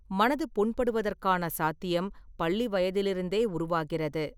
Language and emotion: Tamil, neutral